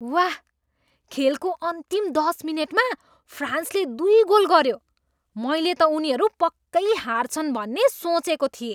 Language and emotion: Nepali, surprised